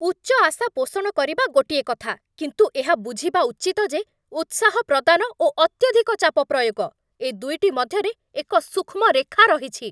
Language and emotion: Odia, angry